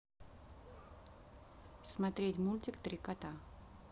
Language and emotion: Russian, neutral